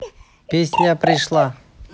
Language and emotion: Russian, neutral